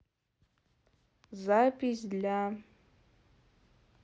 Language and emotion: Russian, neutral